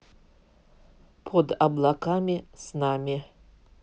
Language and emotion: Russian, neutral